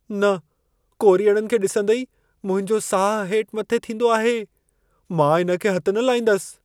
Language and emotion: Sindhi, fearful